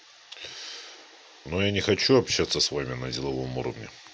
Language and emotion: Russian, neutral